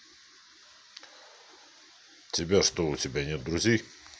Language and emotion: Russian, neutral